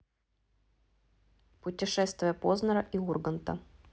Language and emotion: Russian, neutral